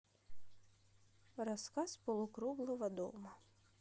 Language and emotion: Russian, neutral